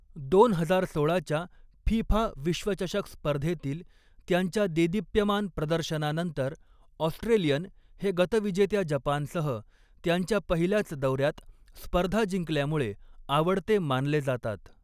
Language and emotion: Marathi, neutral